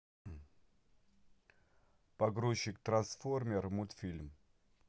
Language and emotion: Russian, neutral